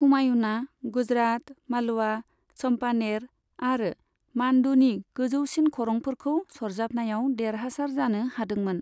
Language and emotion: Bodo, neutral